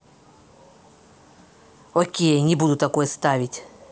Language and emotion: Russian, angry